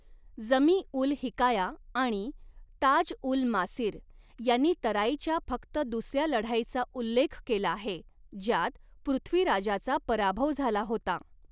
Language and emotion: Marathi, neutral